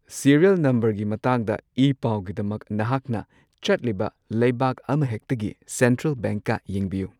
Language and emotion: Manipuri, neutral